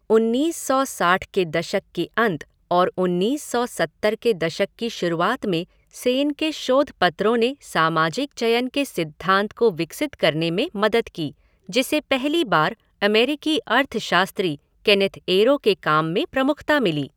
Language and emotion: Hindi, neutral